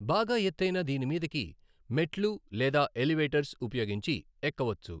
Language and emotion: Telugu, neutral